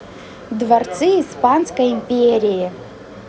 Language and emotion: Russian, positive